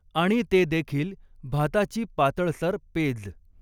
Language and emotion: Marathi, neutral